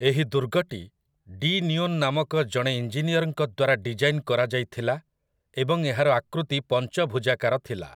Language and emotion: Odia, neutral